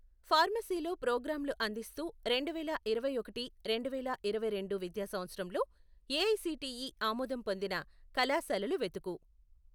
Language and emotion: Telugu, neutral